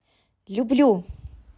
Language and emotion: Russian, positive